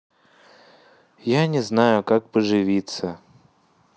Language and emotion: Russian, sad